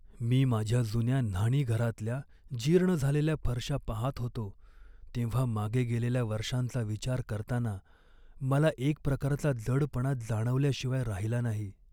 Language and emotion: Marathi, sad